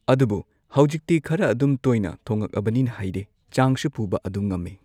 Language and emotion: Manipuri, neutral